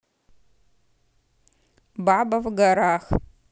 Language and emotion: Russian, neutral